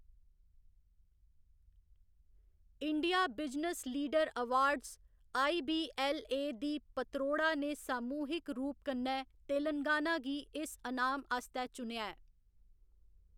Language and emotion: Dogri, neutral